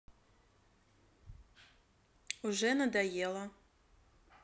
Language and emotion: Russian, neutral